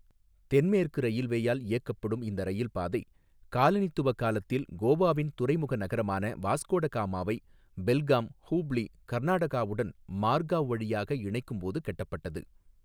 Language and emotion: Tamil, neutral